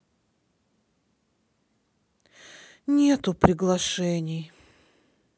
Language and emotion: Russian, sad